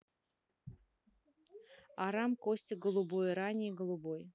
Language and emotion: Russian, neutral